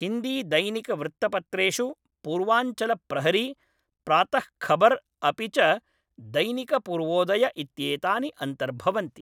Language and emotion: Sanskrit, neutral